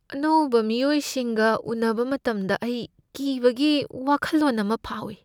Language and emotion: Manipuri, fearful